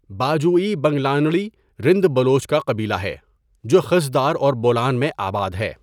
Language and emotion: Urdu, neutral